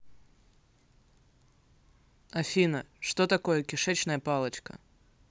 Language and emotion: Russian, neutral